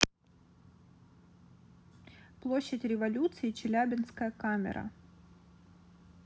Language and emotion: Russian, neutral